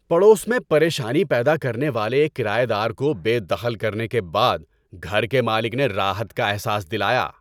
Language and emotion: Urdu, happy